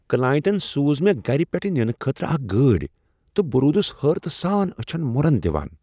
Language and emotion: Kashmiri, surprised